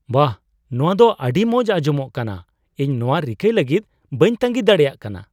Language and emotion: Santali, surprised